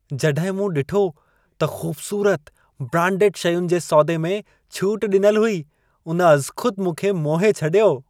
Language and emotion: Sindhi, happy